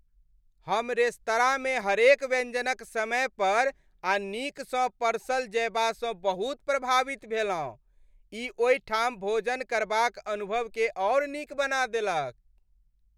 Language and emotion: Maithili, happy